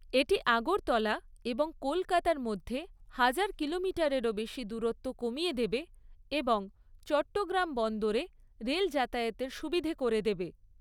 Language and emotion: Bengali, neutral